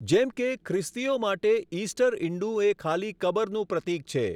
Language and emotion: Gujarati, neutral